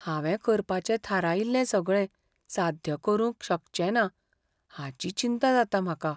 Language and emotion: Goan Konkani, fearful